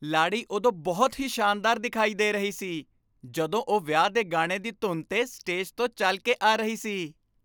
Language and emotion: Punjabi, happy